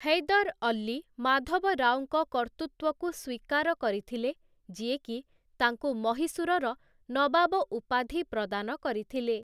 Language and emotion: Odia, neutral